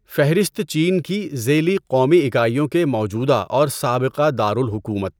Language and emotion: Urdu, neutral